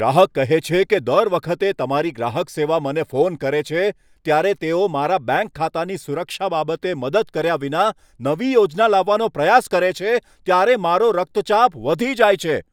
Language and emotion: Gujarati, angry